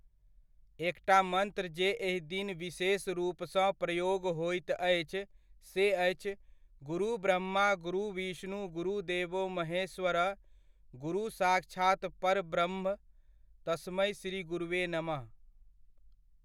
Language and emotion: Maithili, neutral